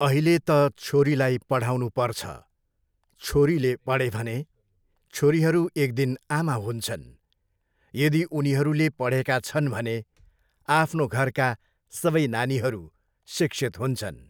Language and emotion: Nepali, neutral